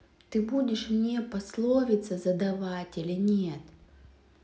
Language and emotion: Russian, angry